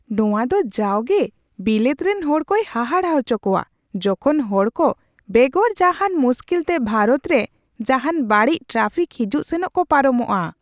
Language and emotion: Santali, surprised